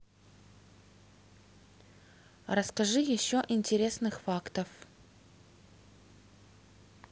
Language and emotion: Russian, neutral